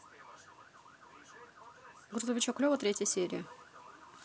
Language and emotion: Russian, neutral